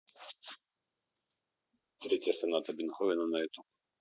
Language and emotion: Russian, neutral